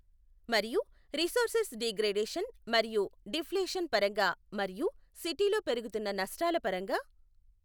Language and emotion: Telugu, neutral